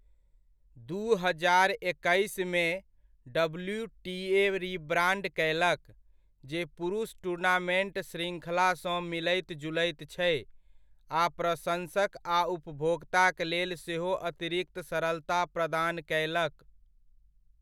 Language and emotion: Maithili, neutral